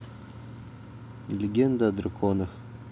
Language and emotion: Russian, neutral